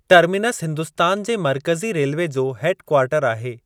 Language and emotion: Sindhi, neutral